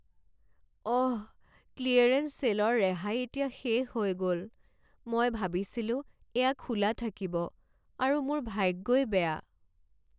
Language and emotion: Assamese, sad